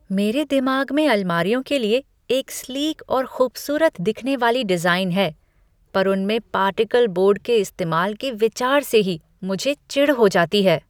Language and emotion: Hindi, disgusted